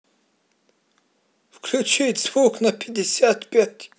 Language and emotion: Russian, positive